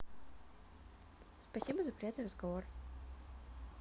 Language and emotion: Russian, neutral